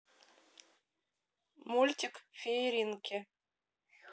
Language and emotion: Russian, neutral